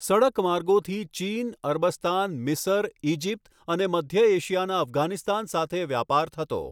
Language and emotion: Gujarati, neutral